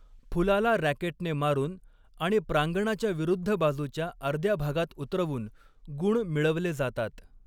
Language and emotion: Marathi, neutral